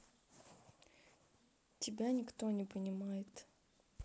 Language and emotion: Russian, neutral